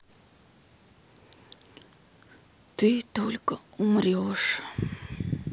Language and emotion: Russian, sad